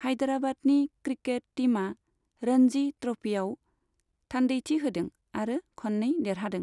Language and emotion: Bodo, neutral